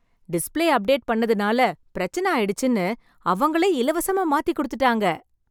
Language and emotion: Tamil, happy